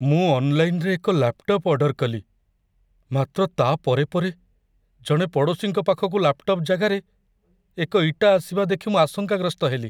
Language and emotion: Odia, fearful